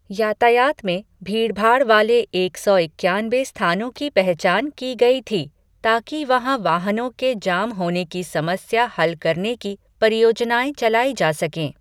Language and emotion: Hindi, neutral